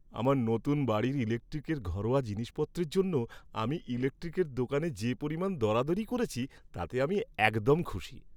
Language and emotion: Bengali, happy